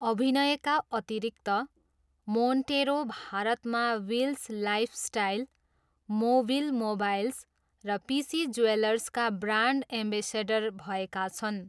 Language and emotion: Nepali, neutral